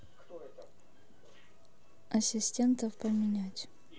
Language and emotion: Russian, neutral